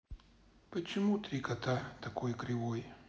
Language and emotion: Russian, sad